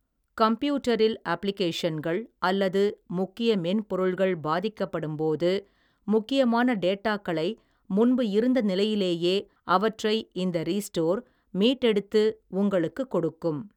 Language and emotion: Tamil, neutral